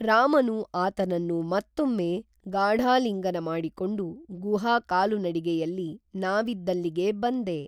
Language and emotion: Kannada, neutral